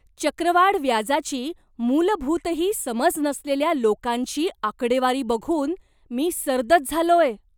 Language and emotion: Marathi, surprised